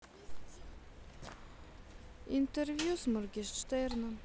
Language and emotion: Russian, sad